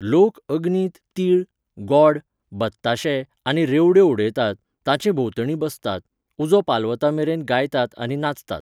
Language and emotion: Goan Konkani, neutral